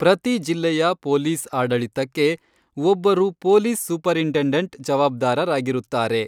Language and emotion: Kannada, neutral